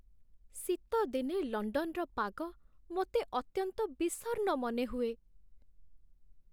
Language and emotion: Odia, sad